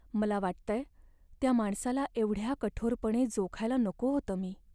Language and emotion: Marathi, sad